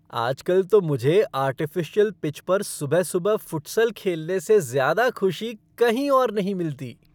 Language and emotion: Hindi, happy